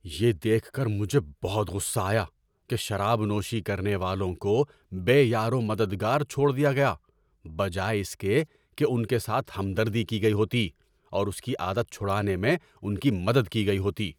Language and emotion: Urdu, angry